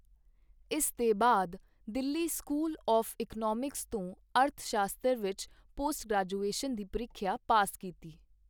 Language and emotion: Punjabi, neutral